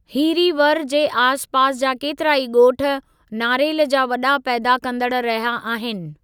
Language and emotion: Sindhi, neutral